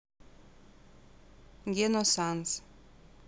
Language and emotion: Russian, neutral